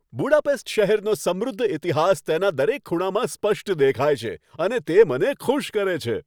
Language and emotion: Gujarati, happy